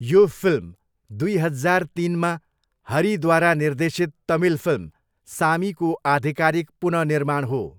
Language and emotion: Nepali, neutral